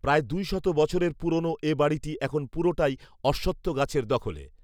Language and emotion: Bengali, neutral